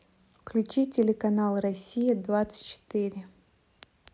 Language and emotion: Russian, neutral